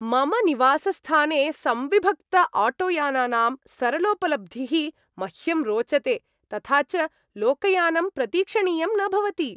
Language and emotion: Sanskrit, happy